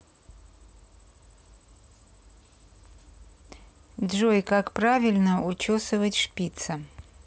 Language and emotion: Russian, neutral